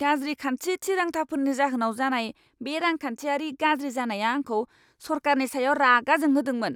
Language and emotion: Bodo, angry